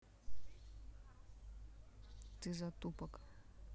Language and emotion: Russian, neutral